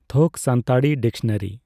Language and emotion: Santali, neutral